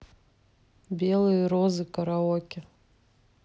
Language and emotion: Russian, neutral